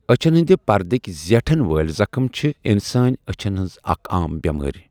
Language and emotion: Kashmiri, neutral